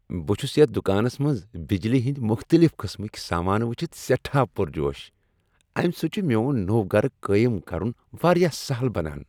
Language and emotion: Kashmiri, happy